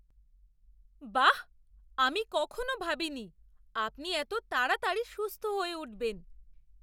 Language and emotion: Bengali, surprised